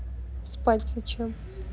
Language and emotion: Russian, neutral